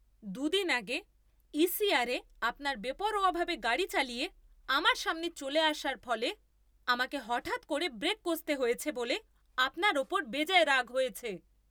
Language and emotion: Bengali, angry